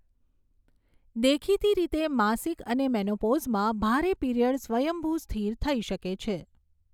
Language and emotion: Gujarati, neutral